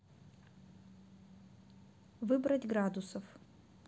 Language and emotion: Russian, neutral